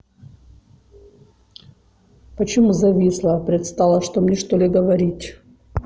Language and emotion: Russian, neutral